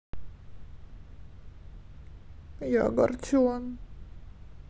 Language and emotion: Russian, sad